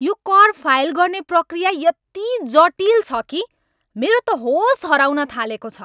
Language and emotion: Nepali, angry